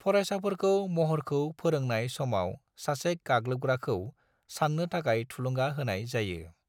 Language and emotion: Bodo, neutral